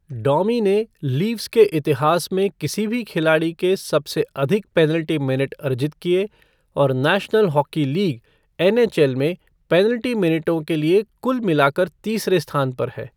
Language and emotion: Hindi, neutral